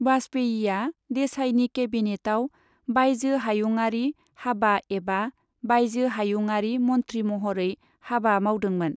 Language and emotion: Bodo, neutral